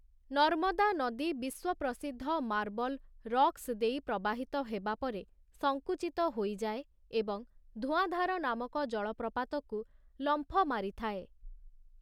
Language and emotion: Odia, neutral